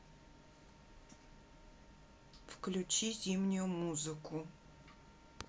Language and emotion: Russian, neutral